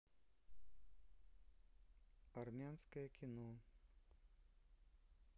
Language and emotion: Russian, neutral